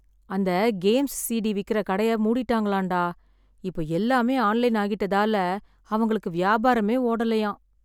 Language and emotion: Tamil, sad